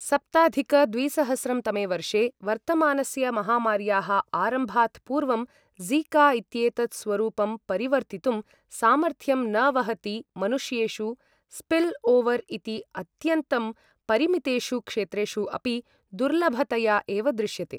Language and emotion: Sanskrit, neutral